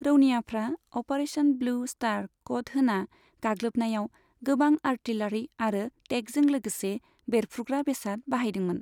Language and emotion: Bodo, neutral